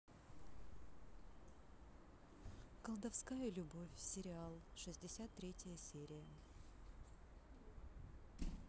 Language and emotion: Russian, neutral